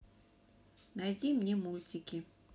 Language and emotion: Russian, neutral